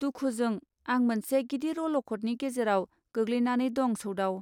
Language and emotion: Bodo, neutral